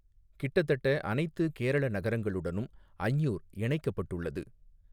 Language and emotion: Tamil, neutral